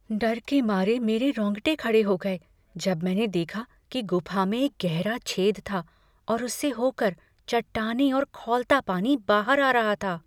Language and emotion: Hindi, fearful